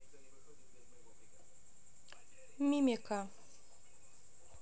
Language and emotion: Russian, neutral